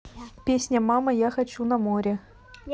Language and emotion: Russian, neutral